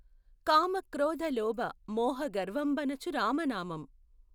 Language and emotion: Telugu, neutral